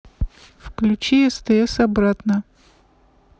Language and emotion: Russian, neutral